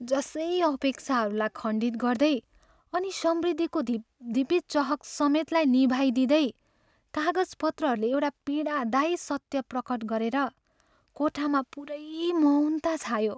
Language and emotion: Nepali, sad